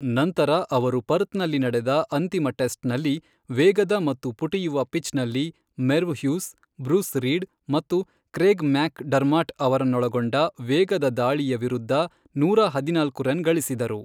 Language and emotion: Kannada, neutral